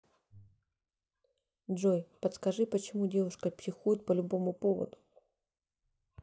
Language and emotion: Russian, neutral